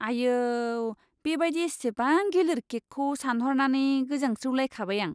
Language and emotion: Bodo, disgusted